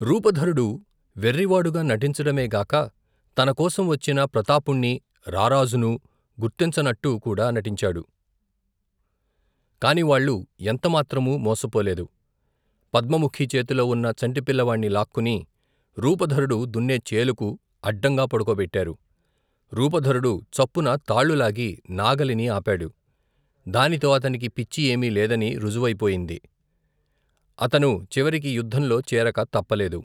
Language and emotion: Telugu, neutral